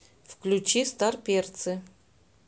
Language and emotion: Russian, neutral